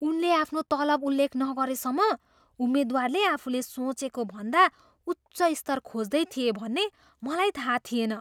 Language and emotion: Nepali, surprised